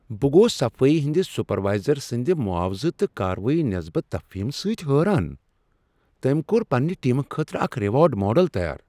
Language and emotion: Kashmiri, surprised